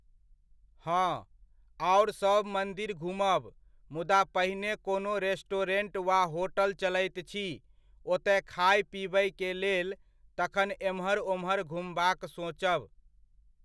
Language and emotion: Maithili, neutral